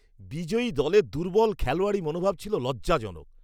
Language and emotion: Bengali, disgusted